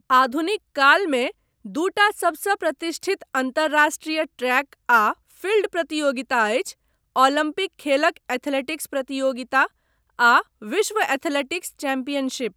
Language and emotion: Maithili, neutral